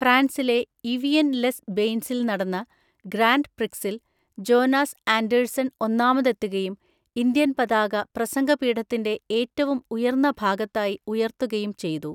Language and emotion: Malayalam, neutral